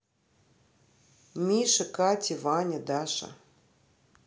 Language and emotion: Russian, neutral